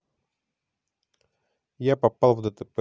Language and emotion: Russian, neutral